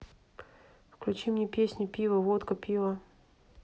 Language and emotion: Russian, neutral